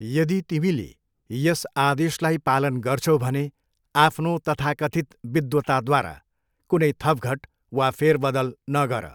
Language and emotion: Nepali, neutral